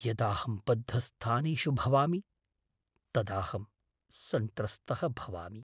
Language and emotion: Sanskrit, fearful